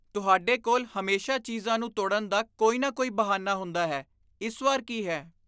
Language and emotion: Punjabi, disgusted